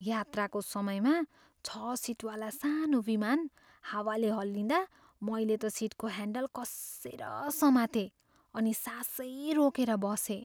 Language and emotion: Nepali, fearful